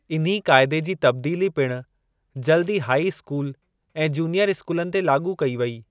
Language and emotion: Sindhi, neutral